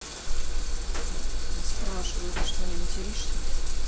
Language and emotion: Russian, neutral